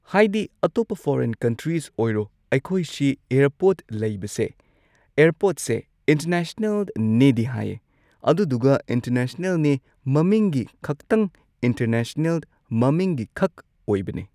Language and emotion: Manipuri, neutral